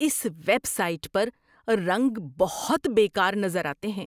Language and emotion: Urdu, disgusted